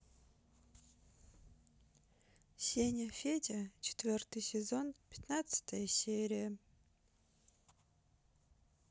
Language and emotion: Russian, sad